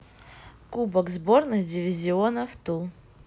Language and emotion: Russian, neutral